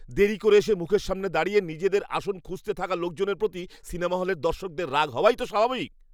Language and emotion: Bengali, angry